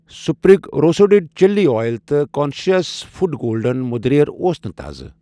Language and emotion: Kashmiri, neutral